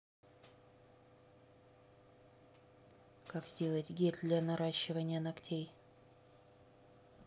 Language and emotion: Russian, neutral